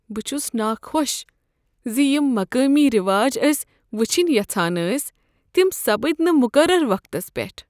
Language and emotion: Kashmiri, sad